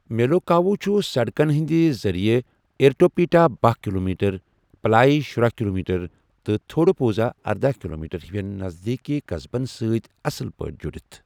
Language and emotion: Kashmiri, neutral